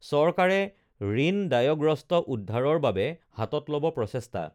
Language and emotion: Assamese, neutral